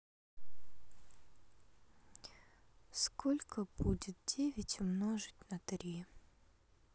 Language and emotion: Russian, sad